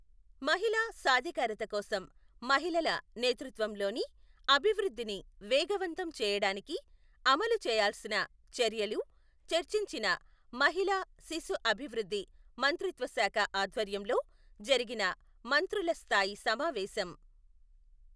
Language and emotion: Telugu, neutral